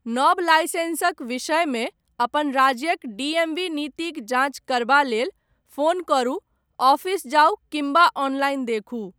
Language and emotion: Maithili, neutral